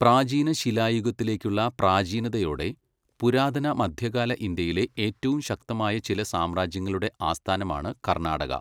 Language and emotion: Malayalam, neutral